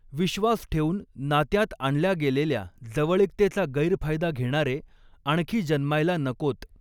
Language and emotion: Marathi, neutral